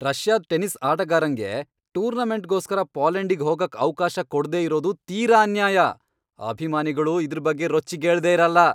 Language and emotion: Kannada, angry